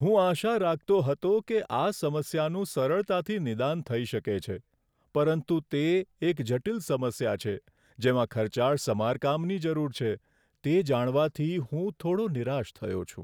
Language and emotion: Gujarati, sad